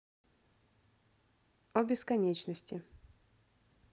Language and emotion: Russian, neutral